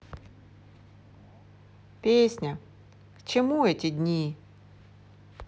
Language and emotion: Russian, sad